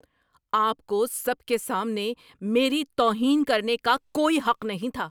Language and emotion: Urdu, angry